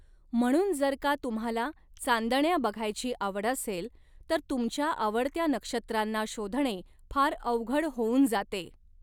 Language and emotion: Marathi, neutral